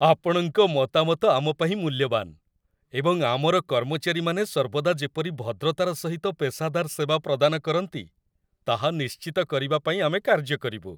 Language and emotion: Odia, happy